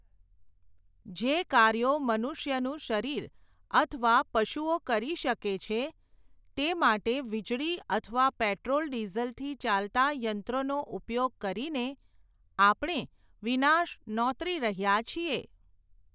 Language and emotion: Gujarati, neutral